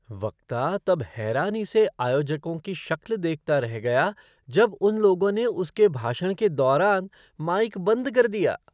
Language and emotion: Hindi, surprised